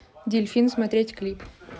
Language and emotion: Russian, neutral